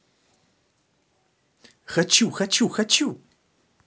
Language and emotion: Russian, positive